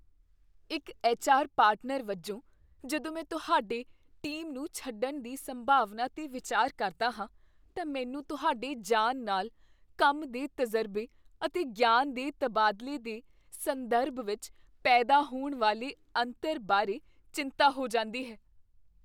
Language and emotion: Punjabi, fearful